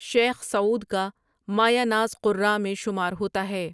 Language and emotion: Urdu, neutral